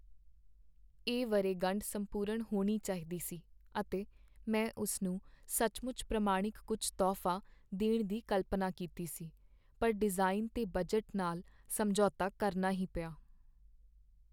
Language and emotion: Punjabi, sad